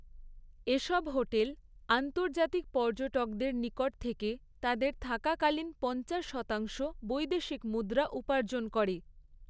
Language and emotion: Bengali, neutral